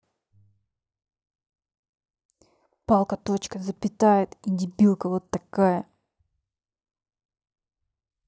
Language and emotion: Russian, angry